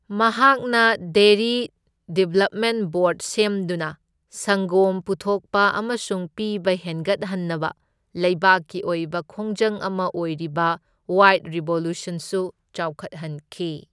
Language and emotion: Manipuri, neutral